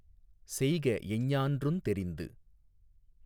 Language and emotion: Tamil, neutral